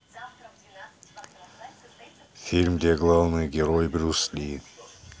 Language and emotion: Russian, neutral